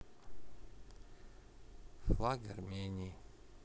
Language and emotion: Russian, neutral